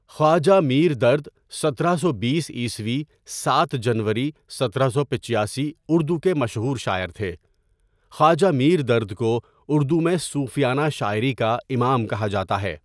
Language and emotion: Urdu, neutral